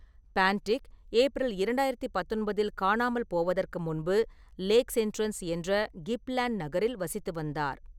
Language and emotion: Tamil, neutral